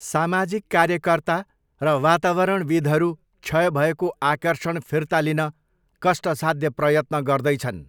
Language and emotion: Nepali, neutral